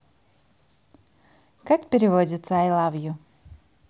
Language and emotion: Russian, positive